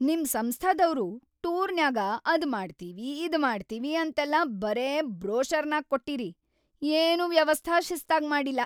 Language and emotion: Kannada, angry